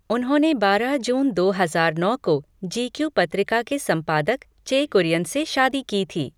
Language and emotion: Hindi, neutral